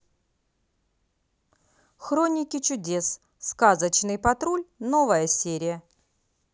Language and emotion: Russian, positive